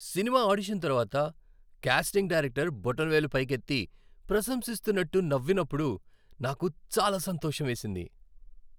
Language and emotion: Telugu, happy